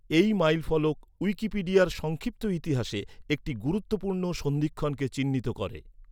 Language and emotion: Bengali, neutral